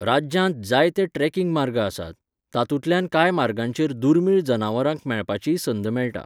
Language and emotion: Goan Konkani, neutral